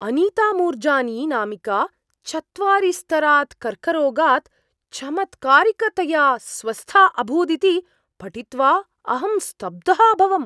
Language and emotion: Sanskrit, surprised